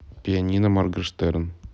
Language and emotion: Russian, neutral